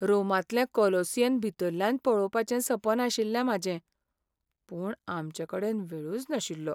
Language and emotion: Goan Konkani, sad